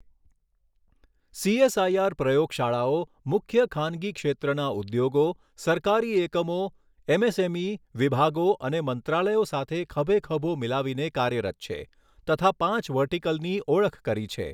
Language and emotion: Gujarati, neutral